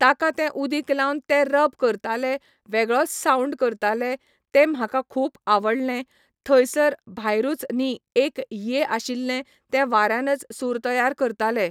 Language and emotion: Goan Konkani, neutral